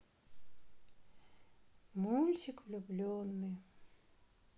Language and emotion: Russian, sad